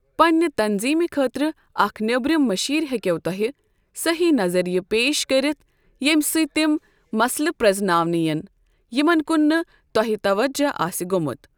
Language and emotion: Kashmiri, neutral